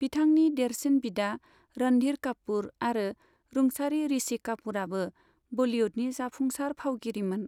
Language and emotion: Bodo, neutral